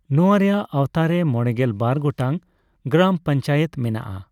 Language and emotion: Santali, neutral